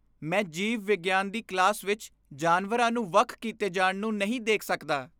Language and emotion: Punjabi, disgusted